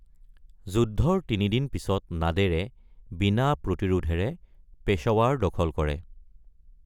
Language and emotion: Assamese, neutral